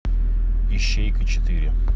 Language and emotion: Russian, neutral